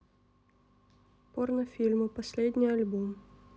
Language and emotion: Russian, neutral